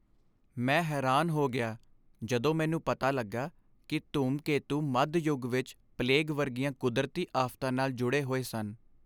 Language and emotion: Punjabi, sad